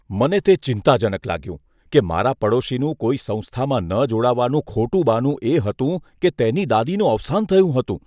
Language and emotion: Gujarati, disgusted